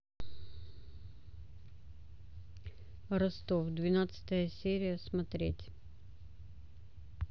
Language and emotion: Russian, neutral